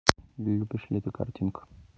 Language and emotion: Russian, neutral